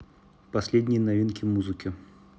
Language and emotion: Russian, neutral